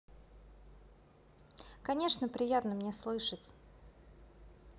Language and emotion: Russian, positive